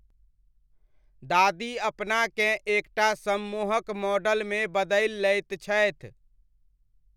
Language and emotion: Maithili, neutral